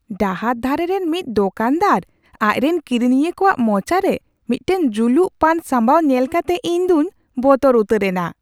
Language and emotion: Santali, surprised